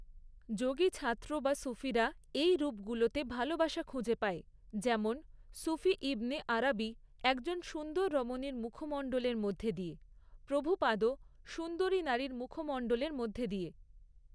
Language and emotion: Bengali, neutral